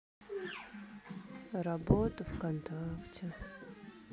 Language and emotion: Russian, sad